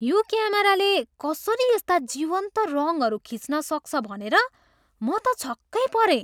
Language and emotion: Nepali, surprised